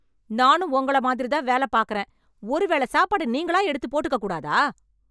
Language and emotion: Tamil, angry